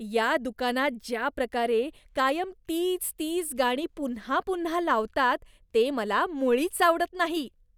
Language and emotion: Marathi, disgusted